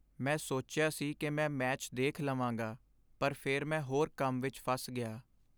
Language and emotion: Punjabi, sad